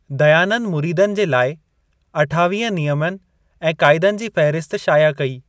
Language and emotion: Sindhi, neutral